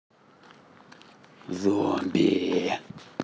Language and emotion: Russian, angry